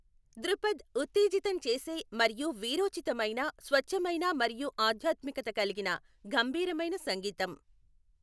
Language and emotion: Telugu, neutral